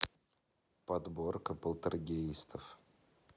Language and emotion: Russian, neutral